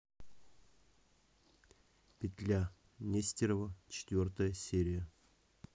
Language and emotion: Russian, neutral